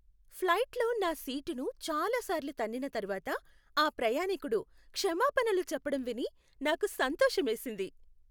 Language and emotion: Telugu, happy